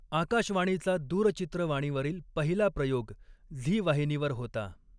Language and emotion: Marathi, neutral